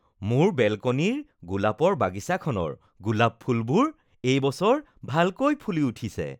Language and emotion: Assamese, happy